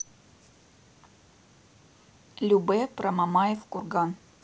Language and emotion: Russian, neutral